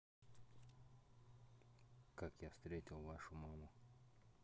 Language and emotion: Russian, neutral